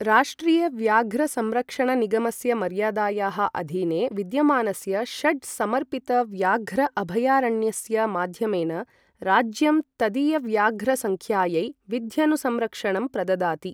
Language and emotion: Sanskrit, neutral